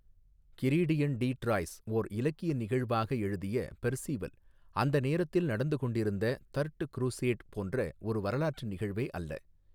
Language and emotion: Tamil, neutral